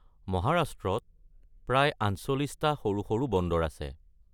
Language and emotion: Assamese, neutral